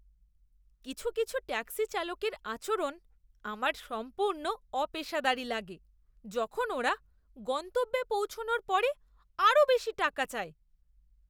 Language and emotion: Bengali, disgusted